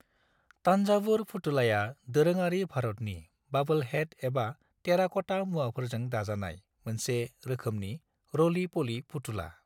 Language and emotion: Bodo, neutral